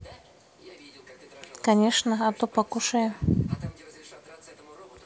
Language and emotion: Russian, neutral